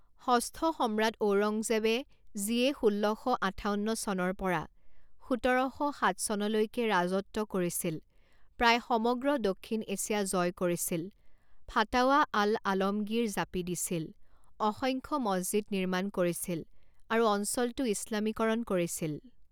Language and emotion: Assamese, neutral